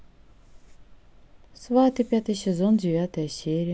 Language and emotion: Russian, neutral